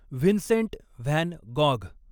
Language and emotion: Marathi, neutral